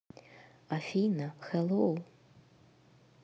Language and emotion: Russian, neutral